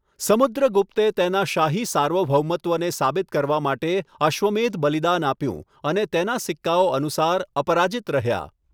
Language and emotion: Gujarati, neutral